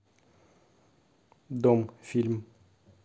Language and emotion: Russian, neutral